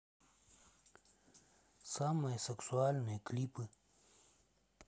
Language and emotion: Russian, neutral